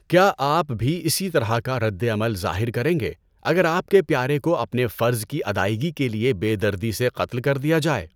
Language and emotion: Urdu, neutral